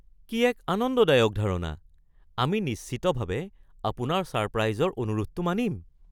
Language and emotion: Assamese, surprised